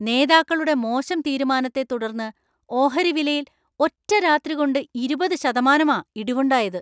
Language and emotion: Malayalam, angry